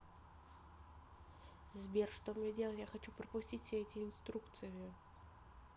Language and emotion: Russian, neutral